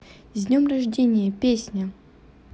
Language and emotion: Russian, neutral